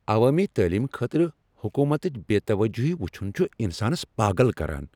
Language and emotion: Kashmiri, angry